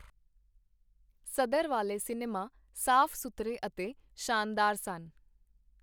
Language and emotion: Punjabi, neutral